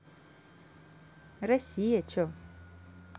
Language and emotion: Russian, positive